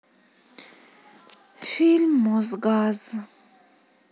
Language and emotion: Russian, sad